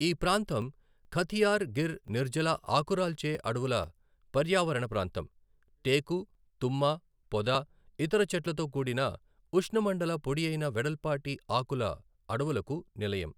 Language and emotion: Telugu, neutral